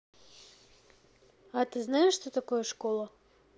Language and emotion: Russian, neutral